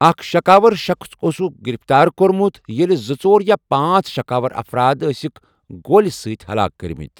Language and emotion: Kashmiri, neutral